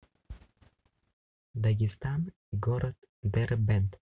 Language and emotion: Russian, neutral